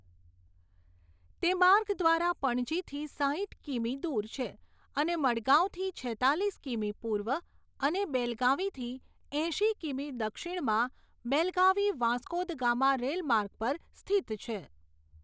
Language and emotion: Gujarati, neutral